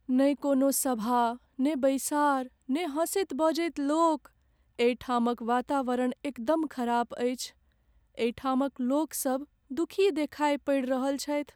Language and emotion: Maithili, sad